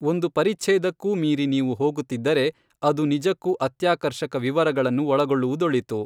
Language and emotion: Kannada, neutral